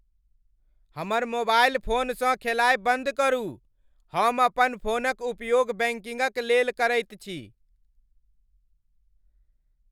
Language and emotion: Maithili, angry